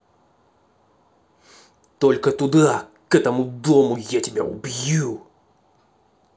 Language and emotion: Russian, angry